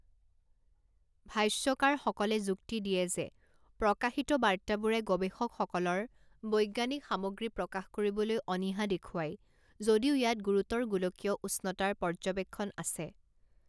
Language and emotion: Assamese, neutral